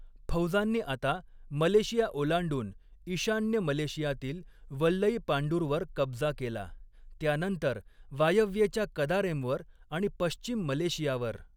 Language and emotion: Marathi, neutral